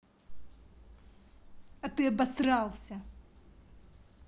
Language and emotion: Russian, angry